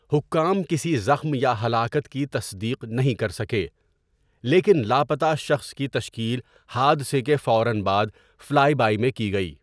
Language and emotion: Urdu, neutral